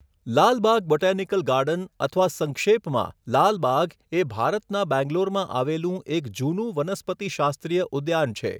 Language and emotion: Gujarati, neutral